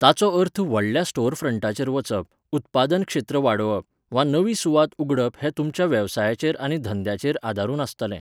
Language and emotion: Goan Konkani, neutral